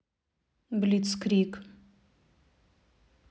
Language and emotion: Russian, neutral